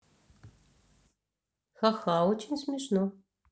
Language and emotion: Russian, neutral